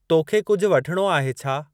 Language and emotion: Sindhi, neutral